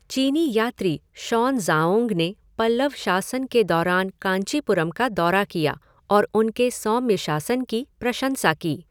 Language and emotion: Hindi, neutral